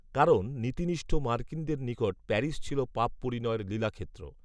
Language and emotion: Bengali, neutral